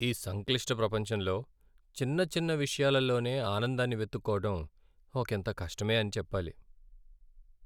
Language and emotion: Telugu, sad